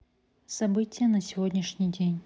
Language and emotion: Russian, neutral